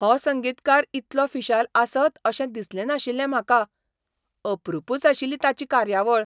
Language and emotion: Goan Konkani, surprised